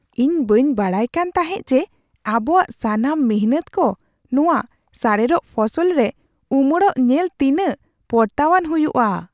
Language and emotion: Santali, surprised